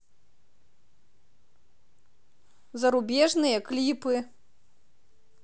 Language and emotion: Russian, neutral